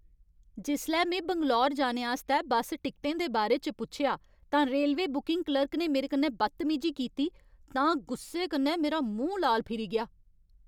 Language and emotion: Dogri, angry